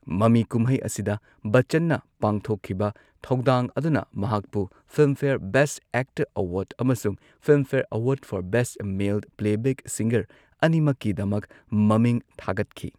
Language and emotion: Manipuri, neutral